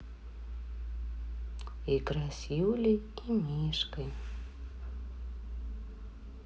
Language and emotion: Russian, neutral